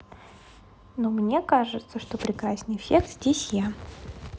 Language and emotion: Russian, positive